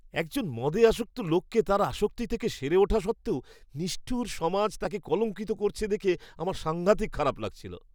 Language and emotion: Bengali, disgusted